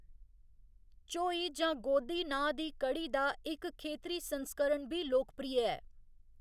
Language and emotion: Dogri, neutral